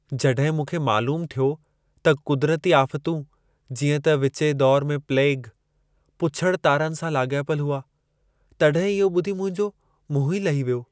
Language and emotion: Sindhi, sad